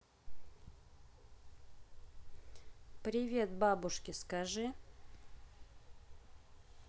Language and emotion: Russian, neutral